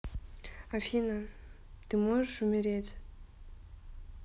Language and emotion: Russian, neutral